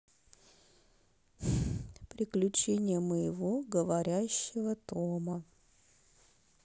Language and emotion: Russian, neutral